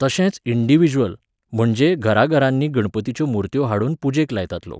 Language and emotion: Goan Konkani, neutral